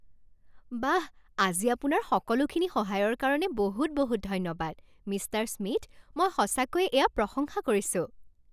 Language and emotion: Assamese, happy